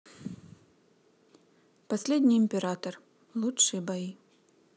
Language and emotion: Russian, neutral